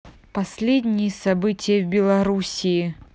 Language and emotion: Russian, angry